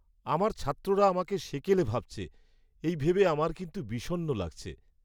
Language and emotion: Bengali, sad